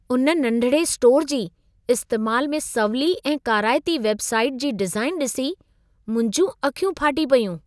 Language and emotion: Sindhi, surprised